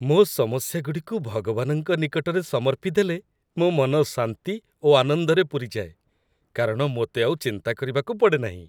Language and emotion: Odia, happy